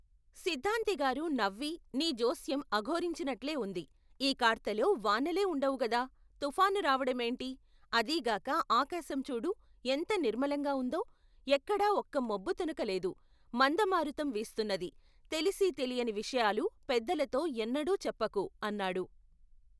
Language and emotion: Telugu, neutral